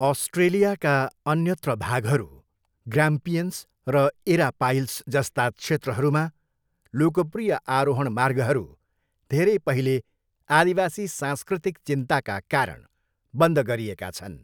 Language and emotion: Nepali, neutral